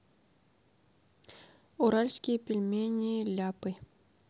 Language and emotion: Russian, neutral